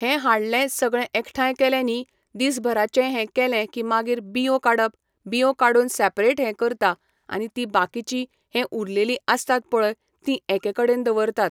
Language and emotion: Goan Konkani, neutral